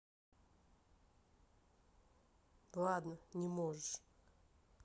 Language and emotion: Russian, neutral